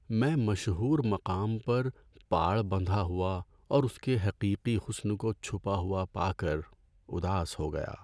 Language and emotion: Urdu, sad